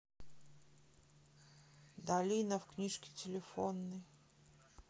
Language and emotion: Russian, neutral